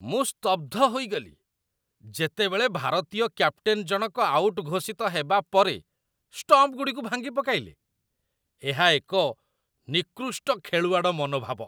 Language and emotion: Odia, disgusted